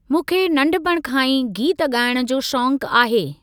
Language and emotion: Sindhi, neutral